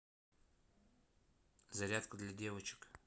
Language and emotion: Russian, neutral